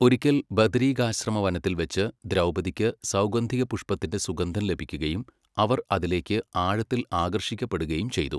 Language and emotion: Malayalam, neutral